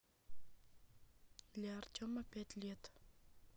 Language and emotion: Russian, neutral